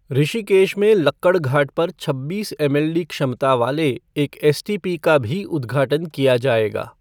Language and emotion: Hindi, neutral